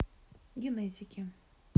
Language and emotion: Russian, neutral